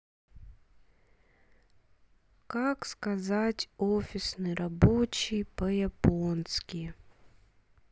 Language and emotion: Russian, sad